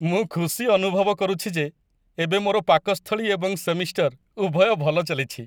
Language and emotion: Odia, happy